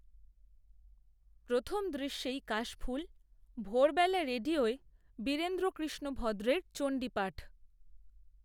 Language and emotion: Bengali, neutral